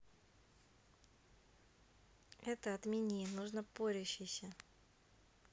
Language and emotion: Russian, neutral